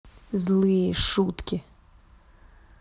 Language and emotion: Russian, angry